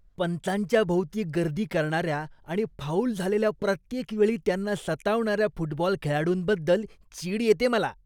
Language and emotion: Marathi, disgusted